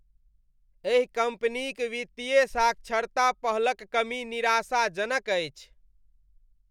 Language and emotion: Maithili, disgusted